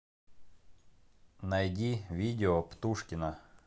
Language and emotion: Russian, neutral